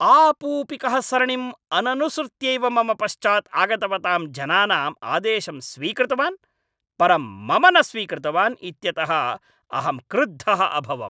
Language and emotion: Sanskrit, angry